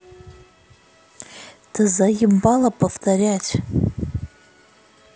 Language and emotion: Russian, angry